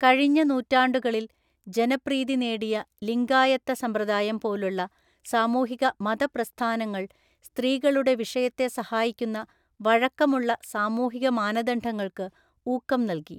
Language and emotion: Malayalam, neutral